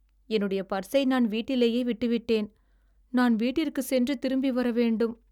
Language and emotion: Tamil, sad